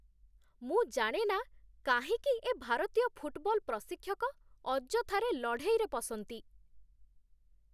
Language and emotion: Odia, disgusted